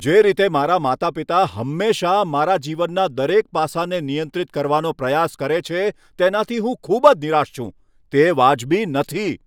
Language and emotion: Gujarati, angry